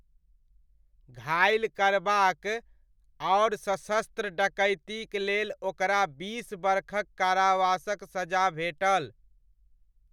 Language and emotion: Maithili, neutral